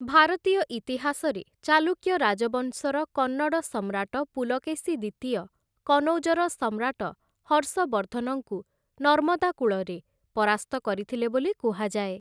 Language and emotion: Odia, neutral